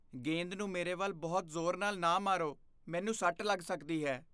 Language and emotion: Punjabi, fearful